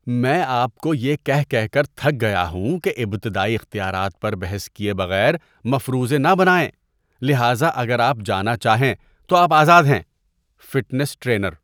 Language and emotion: Urdu, disgusted